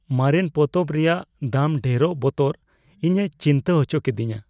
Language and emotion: Santali, fearful